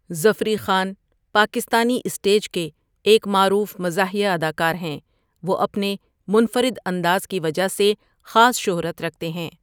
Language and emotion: Urdu, neutral